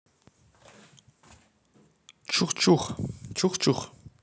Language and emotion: Russian, neutral